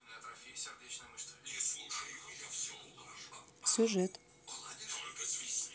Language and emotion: Russian, neutral